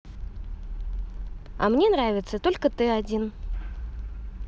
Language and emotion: Russian, positive